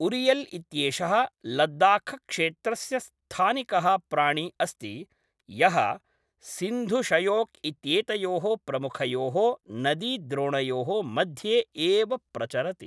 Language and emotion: Sanskrit, neutral